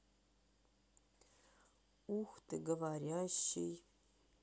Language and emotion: Russian, sad